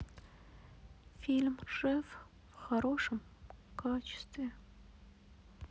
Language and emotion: Russian, sad